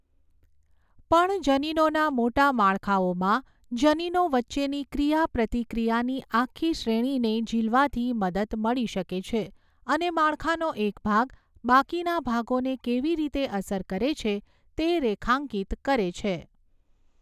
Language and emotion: Gujarati, neutral